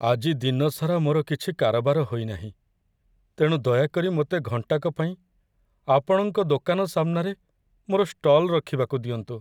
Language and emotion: Odia, sad